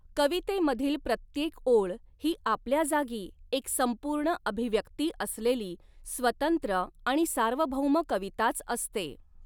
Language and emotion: Marathi, neutral